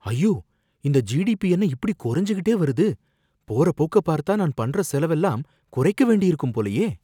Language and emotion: Tamil, fearful